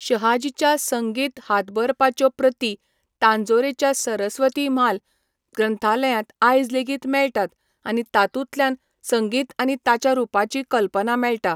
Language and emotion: Goan Konkani, neutral